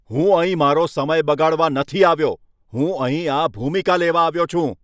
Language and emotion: Gujarati, angry